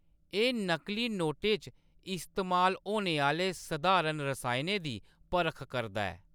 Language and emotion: Dogri, neutral